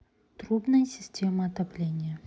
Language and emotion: Russian, neutral